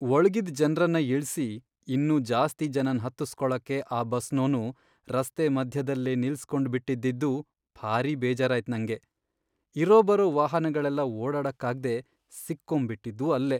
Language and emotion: Kannada, sad